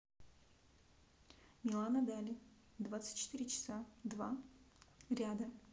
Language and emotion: Russian, neutral